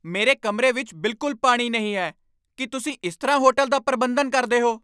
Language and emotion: Punjabi, angry